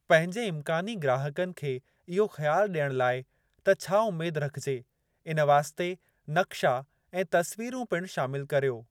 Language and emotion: Sindhi, neutral